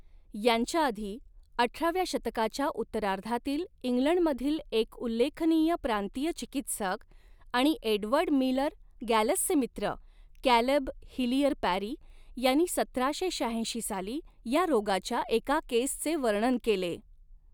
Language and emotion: Marathi, neutral